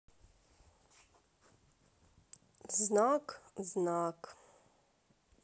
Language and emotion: Russian, neutral